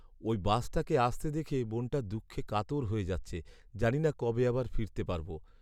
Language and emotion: Bengali, sad